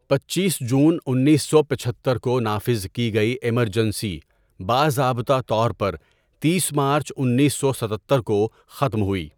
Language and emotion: Urdu, neutral